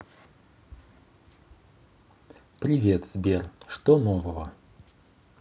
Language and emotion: Russian, neutral